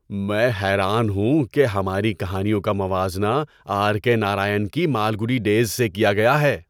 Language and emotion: Urdu, surprised